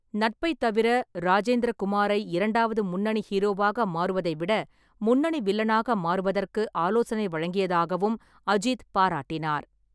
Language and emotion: Tamil, neutral